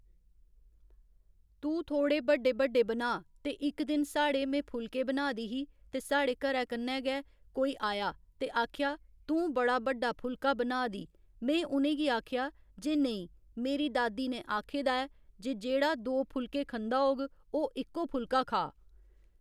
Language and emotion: Dogri, neutral